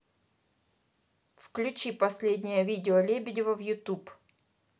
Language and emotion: Russian, neutral